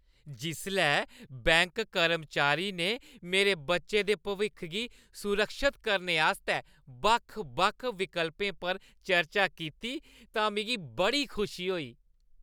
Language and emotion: Dogri, happy